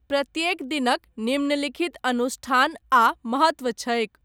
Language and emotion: Maithili, neutral